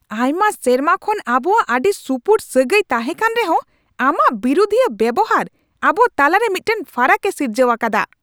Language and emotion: Santali, angry